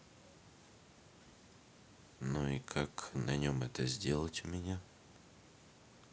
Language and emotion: Russian, neutral